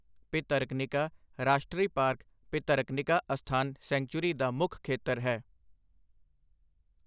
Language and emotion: Punjabi, neutral